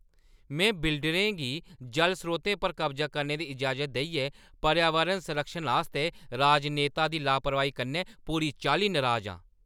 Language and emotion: Dogri, angry